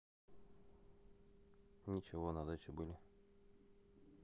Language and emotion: Russian, neutral